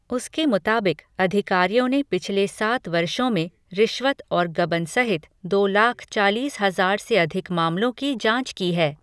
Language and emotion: Hindi, neutral